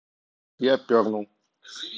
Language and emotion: Russian, neutral